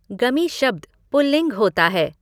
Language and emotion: Hindi, neutral